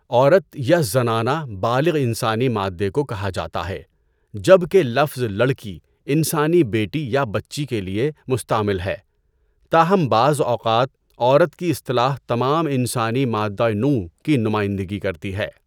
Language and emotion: Urdu, neutral